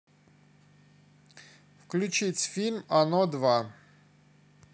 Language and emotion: Russian, neutral